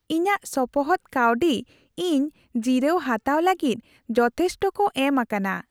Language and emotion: Santali, happy